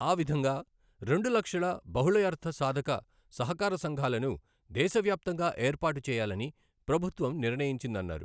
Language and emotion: Telugu, neutral